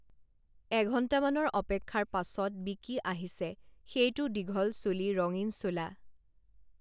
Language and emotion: Assamese, neutral